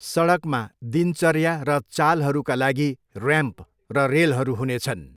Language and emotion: Nepali, neutral